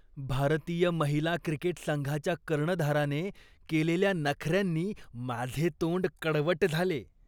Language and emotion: Marathi, disgusted